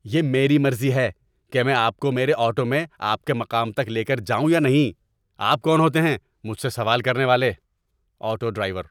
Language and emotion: Urdu, angry